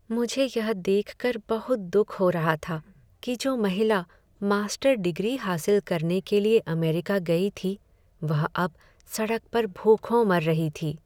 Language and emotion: Hindi, sad